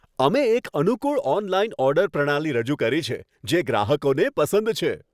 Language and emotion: Gujarati, happy